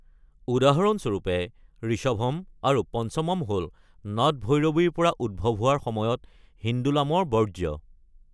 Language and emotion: Assamese, neutral